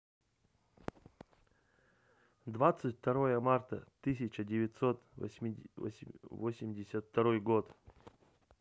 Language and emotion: Russian, neutral